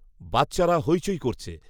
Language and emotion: Bengali, neutral